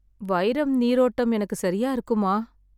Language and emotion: Tamil, sad